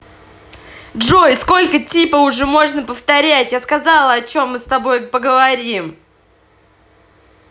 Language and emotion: Russian, angry